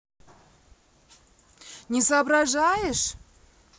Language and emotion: Russian, angry